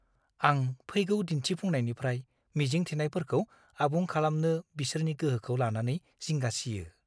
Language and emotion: Bodo, fearful